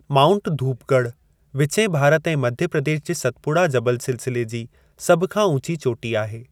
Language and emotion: Sindhi, neutral